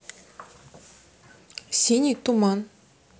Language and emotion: Russian, neutral